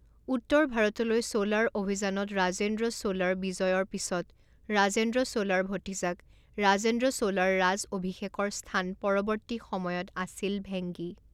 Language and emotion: Assamese, neutral